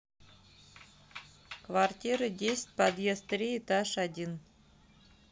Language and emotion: Russian, neutral